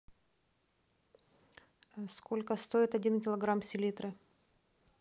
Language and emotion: Russian, neutral